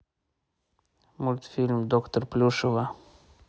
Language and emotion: Russian, neutral